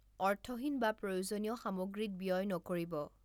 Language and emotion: Assamese, neutral